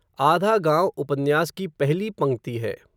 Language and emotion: Hindi, neutral